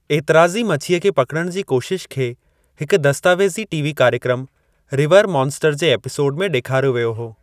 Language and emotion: Sindhi, neutral